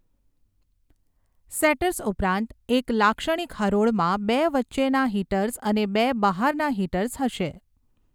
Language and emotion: Gujarati, neutral